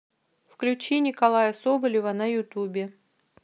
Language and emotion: Russian, neutral